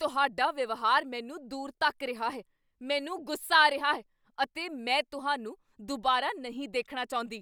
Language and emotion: Punjabi, angry